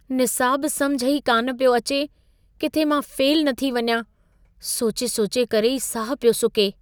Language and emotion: Sindhi, fearful